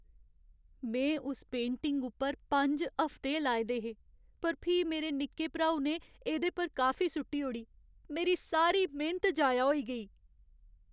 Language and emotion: Dogri, sad